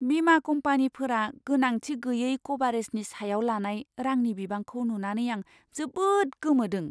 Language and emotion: Bodo, surprised